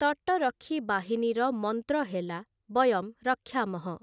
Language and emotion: Odia, neutral